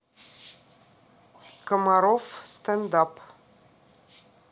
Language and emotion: Russian, neutral